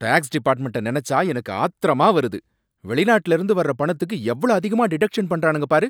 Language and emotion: Tamil, angry